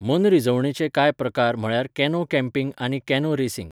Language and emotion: Goan Konkani, neutral